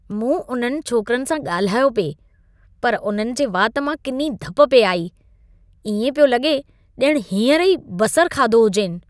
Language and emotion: Sindhi, disgusted